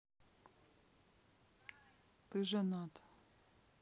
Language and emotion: Russian, sad